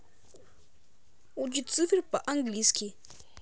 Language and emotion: Russian, positive